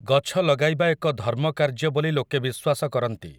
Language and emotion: Odia, neutral